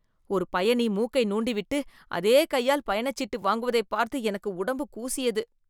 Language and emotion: Tamil, disgusted